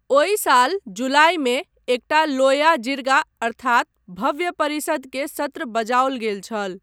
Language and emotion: Maithili, neutral